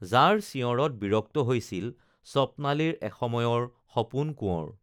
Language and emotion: Assamese, neutral